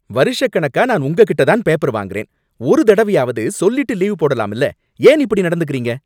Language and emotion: Tamil, angry